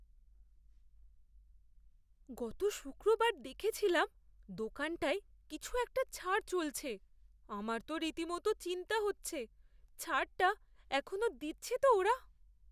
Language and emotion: Bengali, fearful